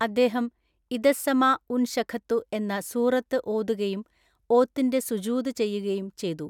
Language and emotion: Malayalam, neutral